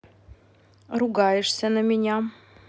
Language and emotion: Russian, angry